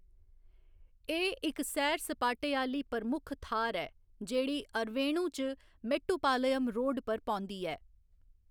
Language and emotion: Dogri, neutral